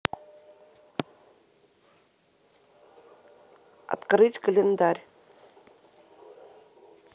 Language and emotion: Russian, neutral